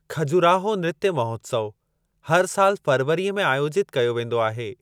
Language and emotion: Sindhi, neutral